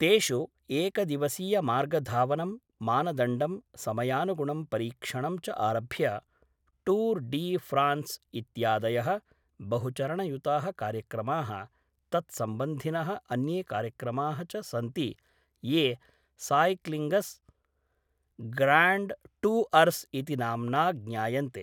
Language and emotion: Sanskrit, neutral